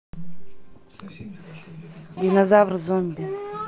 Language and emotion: Russian, neutral